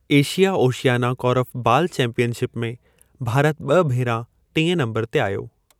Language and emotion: Sindhi, neutral